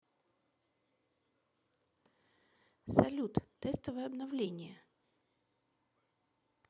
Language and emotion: Russian, neutral